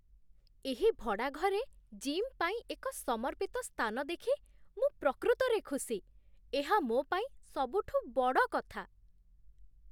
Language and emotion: Odia, surprised